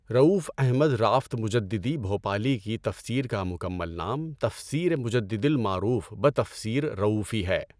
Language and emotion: Urdu, neutral